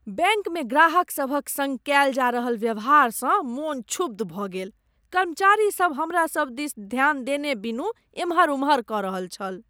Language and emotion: Maithili, disgusted